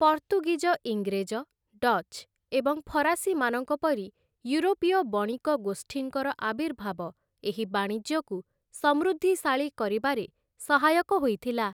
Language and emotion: Odia, neutral